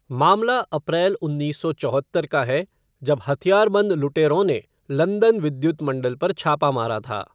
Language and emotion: Hindi, neutral